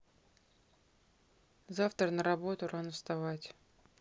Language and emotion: Russian, neutral